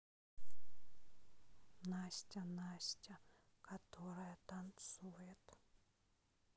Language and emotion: Russian, sad